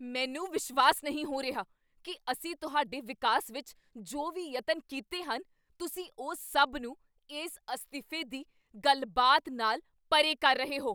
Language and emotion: Punjabi, angry